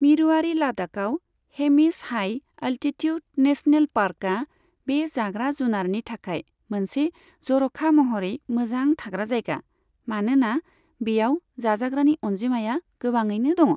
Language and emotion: Bodo, neutral